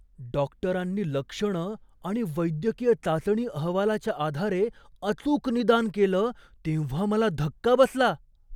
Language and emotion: Marathi, surprised